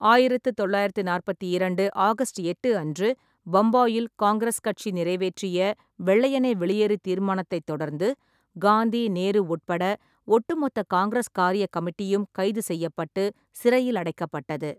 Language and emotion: Tamil, neutral